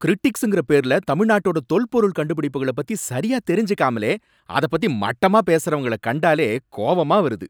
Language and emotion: Tamil, angry